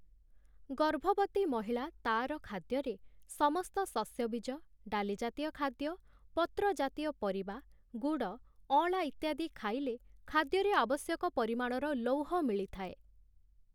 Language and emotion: Odia, neutral